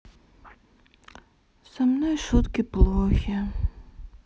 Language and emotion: Russian, sad